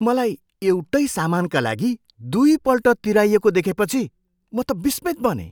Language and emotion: Nepali, surprised